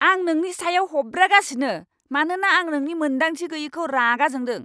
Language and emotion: Bodo, angry